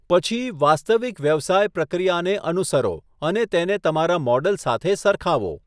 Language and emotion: Gujarati, neutral